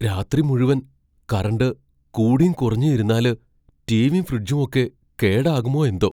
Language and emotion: Malayalam, fearful